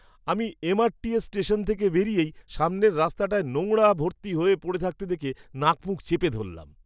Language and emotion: Bengali, disgusted